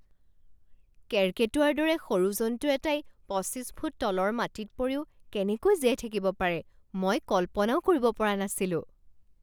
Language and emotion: Assamese, surprised